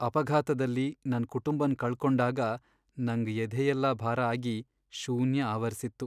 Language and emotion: Kannada, sad